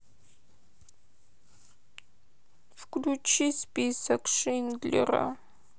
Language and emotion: Russian, sad